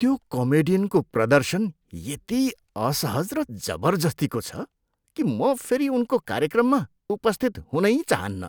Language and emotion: Nepali, disgusted